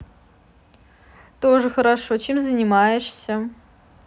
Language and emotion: Russian, neutral